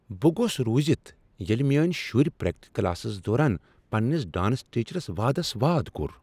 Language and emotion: Kashmiri, surprised